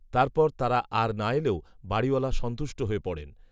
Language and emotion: Bengali, neutral